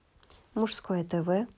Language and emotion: Russian, neutral